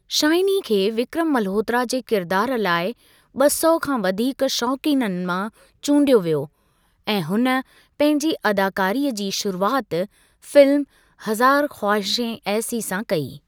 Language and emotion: Sindhi, neutral